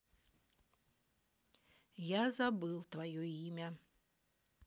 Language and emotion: Russian, neutral